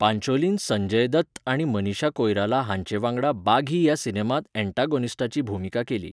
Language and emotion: Goan Konkani, neutral